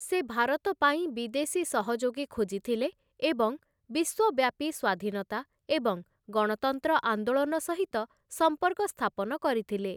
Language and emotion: Odia, neutral